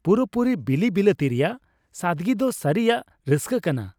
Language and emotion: Santali, happy